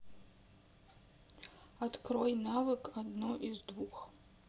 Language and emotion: Russian, neutral